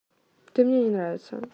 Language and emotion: Russian, neutral